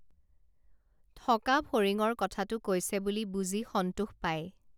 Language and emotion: Assamese, neutral